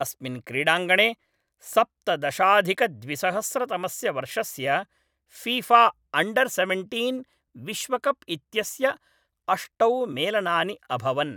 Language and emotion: Sanskrit, neutral